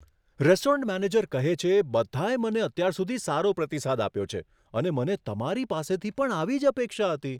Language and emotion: Gujarati, surprised